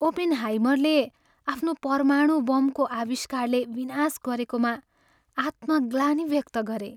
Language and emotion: Nepali, sad